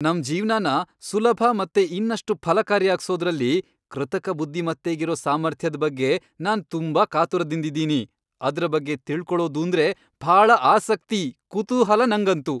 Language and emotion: Kannada, happy